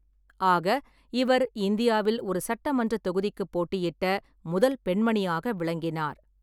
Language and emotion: Tamil, neutral